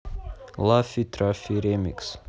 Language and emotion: Russian, neutral